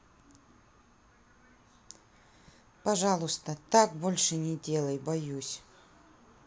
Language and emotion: Russian, neutral